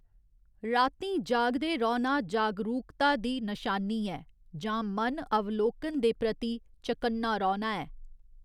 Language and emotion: Dogri, neutral